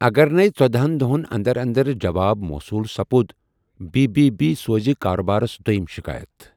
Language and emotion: Kashmiri, neutral